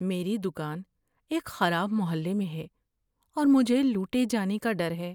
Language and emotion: Urdu, fearful